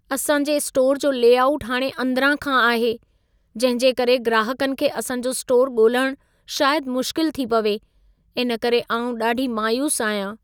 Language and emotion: Sindhi, sad